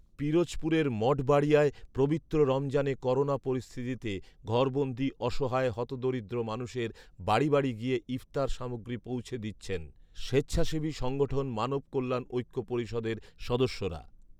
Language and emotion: Bengali, neutral